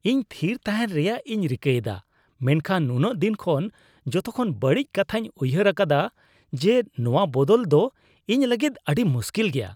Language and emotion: Santali, disgusted